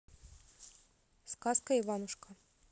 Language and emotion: Russian, neutral